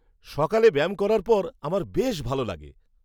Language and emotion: Bengali, happy